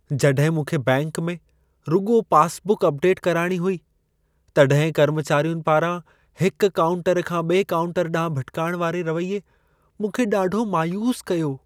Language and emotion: Sindhi, sad